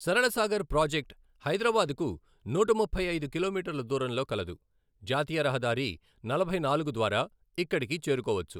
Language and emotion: Telugu, neutral